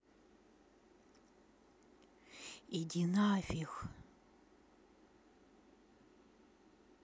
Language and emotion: Russian, angry